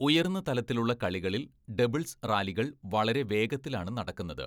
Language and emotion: Malayalam, neutral